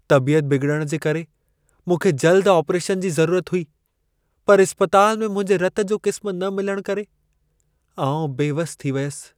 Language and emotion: Sindhi, sad